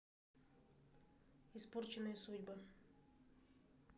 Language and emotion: Russian, neutral